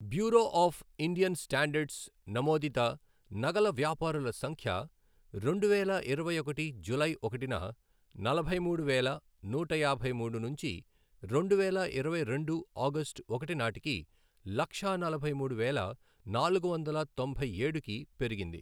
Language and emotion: Telugu, neutral